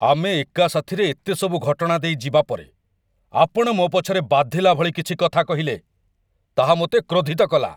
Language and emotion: Odia, angry